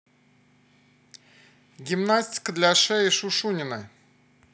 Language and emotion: Russian, positive